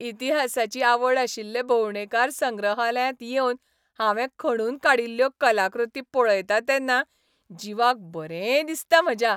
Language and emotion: Goan Konkani, happy